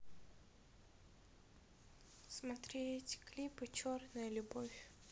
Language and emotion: Russian, sad